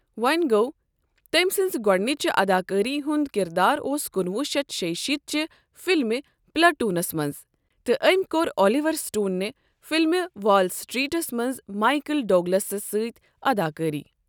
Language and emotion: Kashmiri, neutral